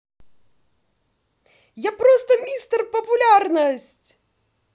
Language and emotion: Russian, positive